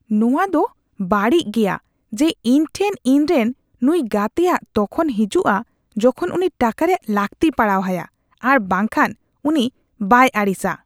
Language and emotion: Santali, disgusted